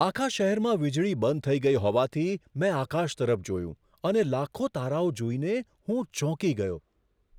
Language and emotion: Gujarati, surprised